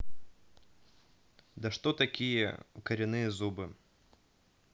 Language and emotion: Russian, neutral